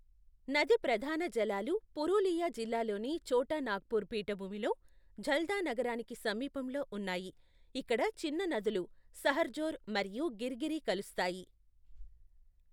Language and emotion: Telugu, neutral